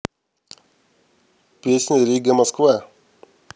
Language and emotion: Russian, neutral